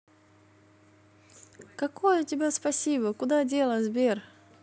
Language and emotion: Russian, positive